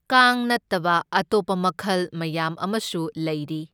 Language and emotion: Manipuri, neutral